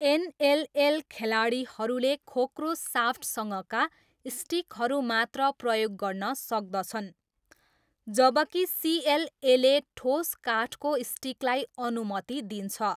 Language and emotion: Nepali, neutral